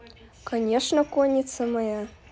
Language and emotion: Russian, neutral